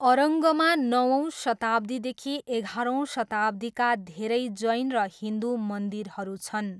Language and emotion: Nepali, neutral